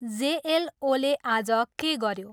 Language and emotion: Nepali, neutral